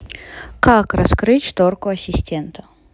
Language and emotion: Russian, neutral